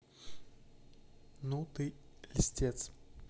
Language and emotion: Russian, neutral